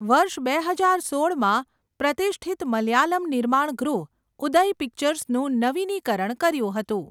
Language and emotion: Gujarati, neutral